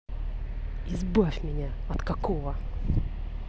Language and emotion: Russian, angry